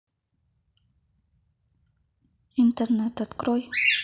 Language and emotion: Russian, neutral